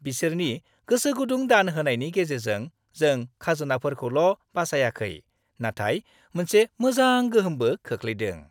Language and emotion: Bodo, happy